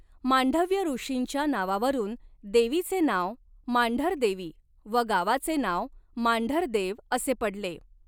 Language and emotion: Marathi, neutral